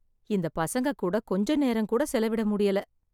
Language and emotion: Tamil, sad